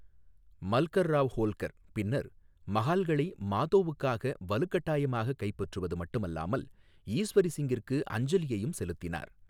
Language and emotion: Tamil, neutral